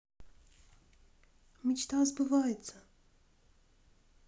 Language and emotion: Russian, neutral